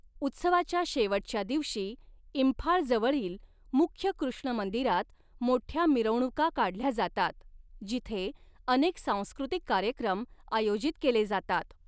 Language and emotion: Marathi, neutral